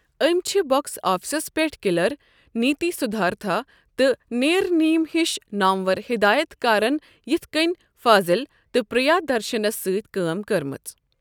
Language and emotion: Kashmiri, neutral